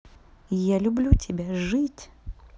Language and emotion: Russian, positive